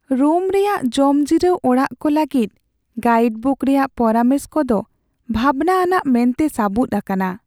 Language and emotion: Santali, sad